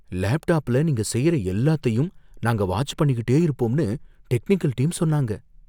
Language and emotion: Tamil, fearful